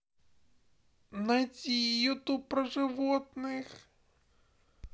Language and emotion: Russian, sad